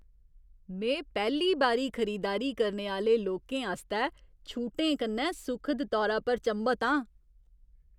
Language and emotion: Dogri, surprised